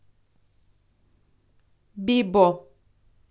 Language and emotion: Russian, neutral